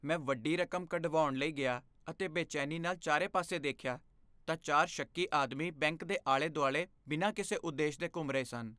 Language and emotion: Punjabi, fearful